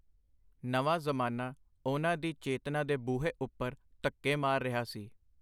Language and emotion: Punjabi, neutral